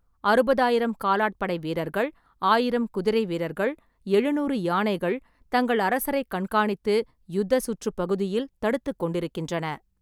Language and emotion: Tamil, neutral